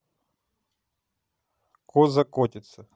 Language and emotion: Russian, neutral